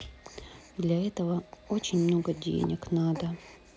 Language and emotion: Russian, sad